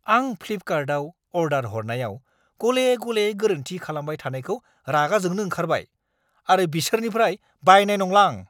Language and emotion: Bodo, angry